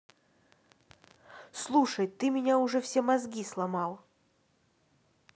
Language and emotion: Russian, neutral